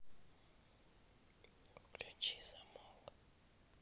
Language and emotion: Russian, neutral